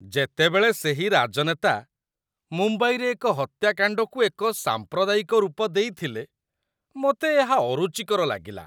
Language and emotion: Odia, disgusted